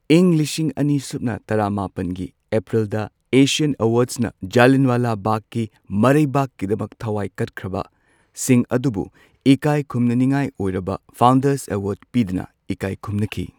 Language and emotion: Manipuri, neutral